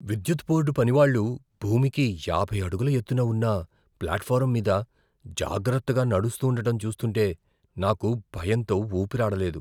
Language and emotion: Telugu, fearful